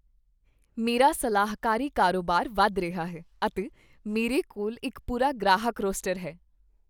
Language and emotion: Punjabi, happy